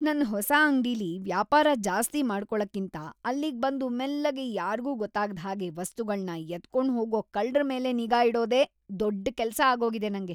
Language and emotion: Kannada, disgusted